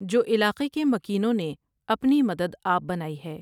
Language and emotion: Urdu, neutral